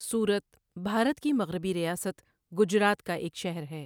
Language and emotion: Urdu, neutral